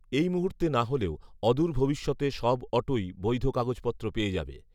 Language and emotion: Bengali, neutral